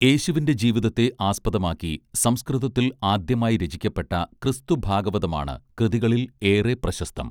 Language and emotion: Malayalam, neutral